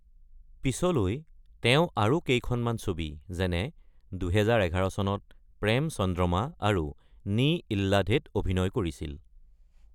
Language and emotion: Assamese, neutral